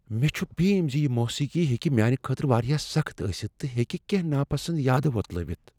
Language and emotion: Kashmiri, fearful